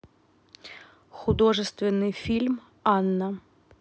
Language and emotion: Russian, neutral